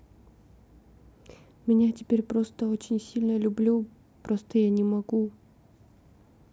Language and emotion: Russian, sad